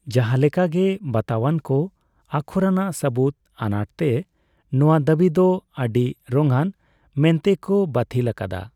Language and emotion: Santali, neutral